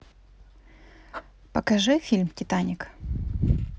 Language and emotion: Russian, positive